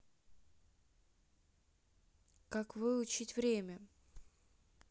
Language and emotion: Russian, neutral